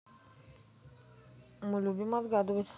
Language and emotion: Russian, neutral